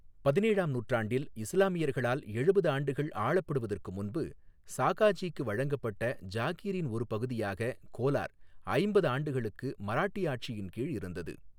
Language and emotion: Tamil, neutral